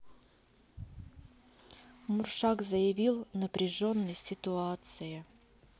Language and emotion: Russian, neutral